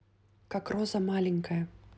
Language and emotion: Russian, neutral